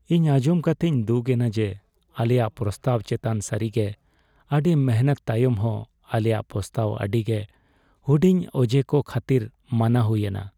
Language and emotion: Santali, sad